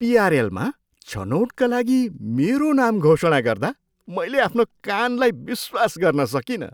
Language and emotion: Nepali, surprised